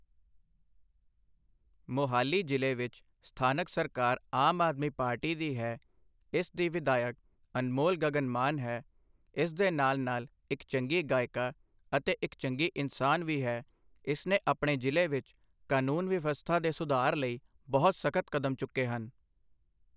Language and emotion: Punjabi, neutral